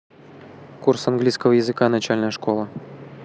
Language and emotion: Russian, neutral